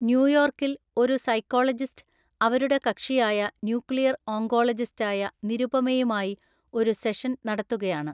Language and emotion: Malayalam, neutral